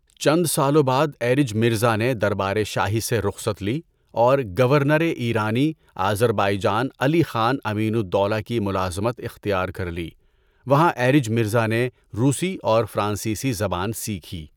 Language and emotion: Urdu, neutral